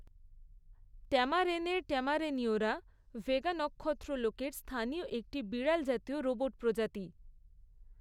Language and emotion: Bengali, neutral